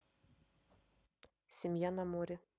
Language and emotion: Russian, neutral